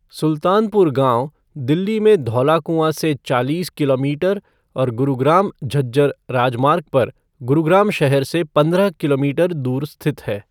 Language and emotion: Hindi, neutral